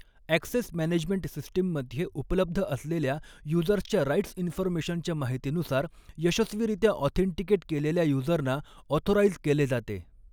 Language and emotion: Marathi, neutral